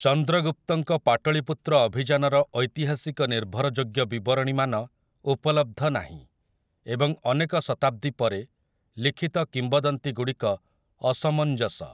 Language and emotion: Odia, neutral